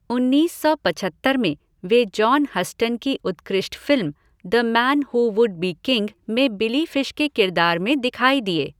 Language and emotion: Hindi, neutral